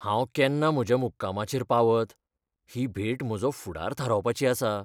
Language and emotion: Goan Konkani, fearful